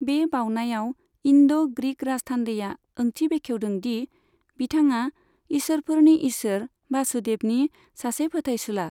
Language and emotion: Bodo, neutral